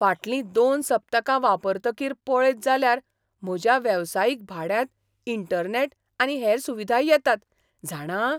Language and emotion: Goan Konkani, surprised